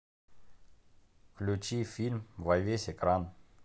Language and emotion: Russian, neutral